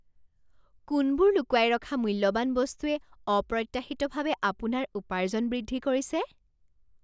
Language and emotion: Assamese, surprised